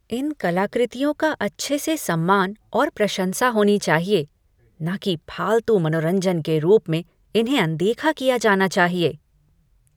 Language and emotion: Hindi, disgusted